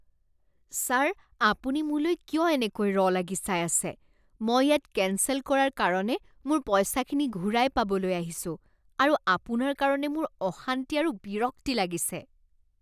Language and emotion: Assamese, disgusted